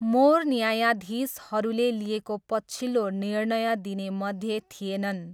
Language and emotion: Nepali, neutral